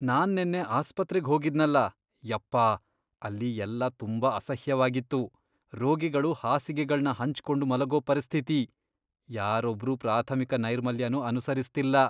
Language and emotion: Kannada, disgusted